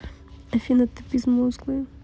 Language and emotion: Russian, neutral